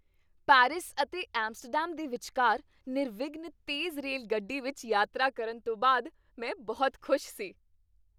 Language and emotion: Punjabi, happy